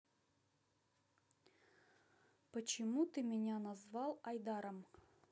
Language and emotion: Russian, neutral